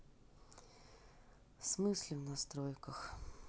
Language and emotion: Russian, sad